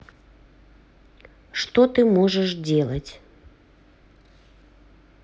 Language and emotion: Russian, neutral